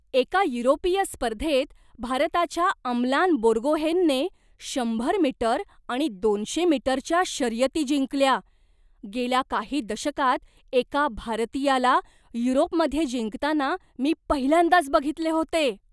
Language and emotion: Marathi, surprised